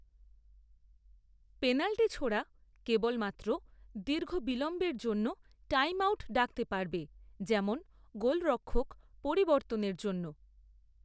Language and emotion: Bengali, neutral